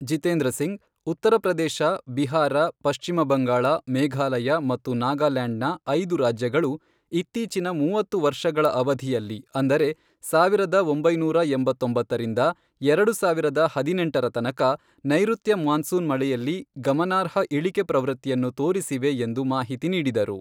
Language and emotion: Kannada, neutral